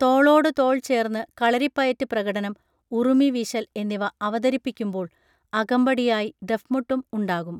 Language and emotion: Malayalam, neutral